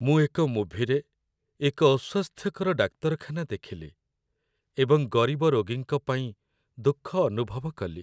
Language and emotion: Odia, sad